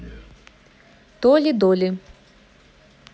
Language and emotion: Russian, neutral